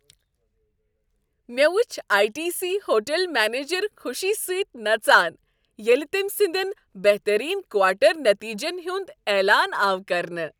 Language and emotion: Kashmiri, happy